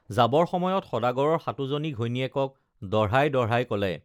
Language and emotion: Assamese, neutral